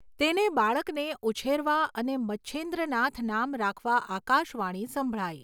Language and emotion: Gujarati, neutral